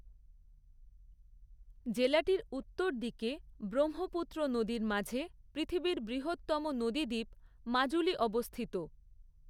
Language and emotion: Bengali, neutral